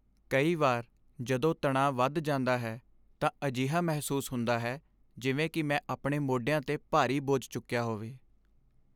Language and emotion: Punjabi, sad